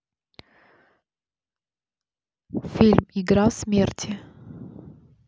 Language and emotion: Russian, neutral